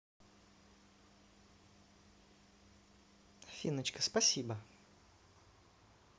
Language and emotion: Russian, neutral